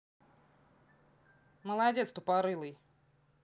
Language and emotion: Russian, angry